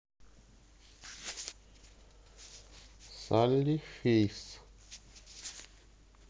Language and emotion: Russian, neutral